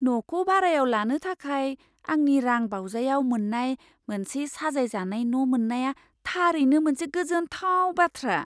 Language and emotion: Bodo, surprised